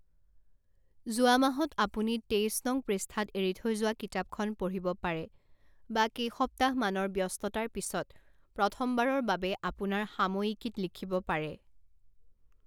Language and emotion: Assamese, neutral